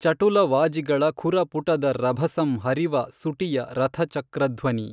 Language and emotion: Kannada, neutral